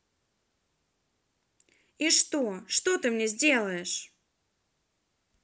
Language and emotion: Russian, angry